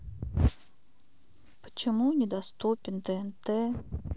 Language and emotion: Russian, sad